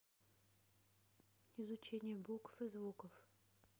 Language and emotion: Russian, neutral